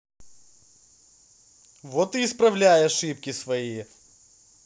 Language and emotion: Russian, angry